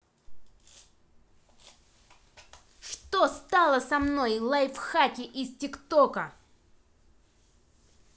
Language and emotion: Russian, angry